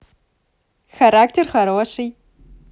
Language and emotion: Russian, positive